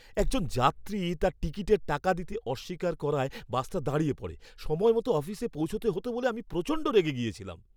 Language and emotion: Bengali, angry